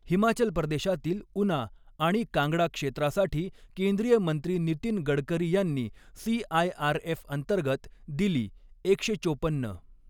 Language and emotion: Marathi, neutral